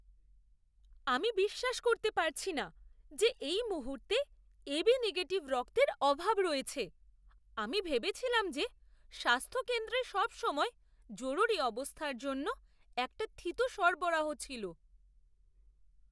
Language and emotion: Bengali, surprised